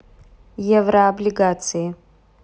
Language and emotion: Russian, neutral